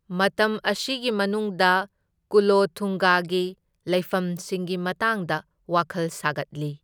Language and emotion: Manipuri, neutral